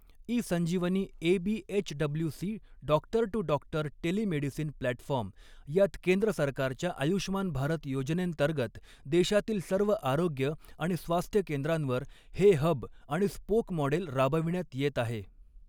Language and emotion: Marathi, neutral